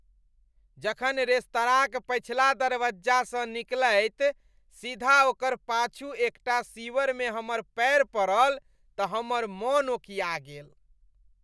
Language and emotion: Maithili, disgusted